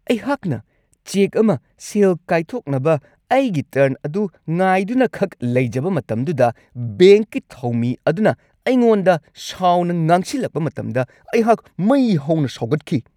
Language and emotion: Manipuri, angry